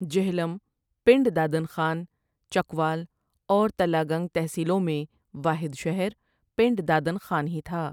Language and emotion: Urdu, neutral